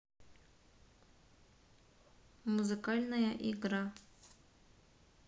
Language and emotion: Russian, neutral